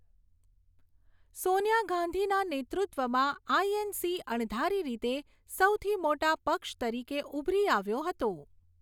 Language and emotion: Gujarati, neutral